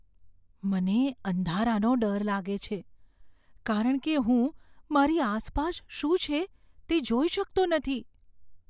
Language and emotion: Gujarati, fearful